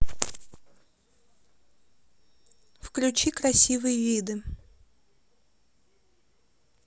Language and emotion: Russian, neutral